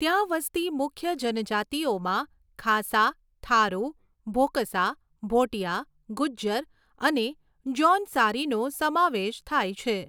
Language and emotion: Gujarati, neutral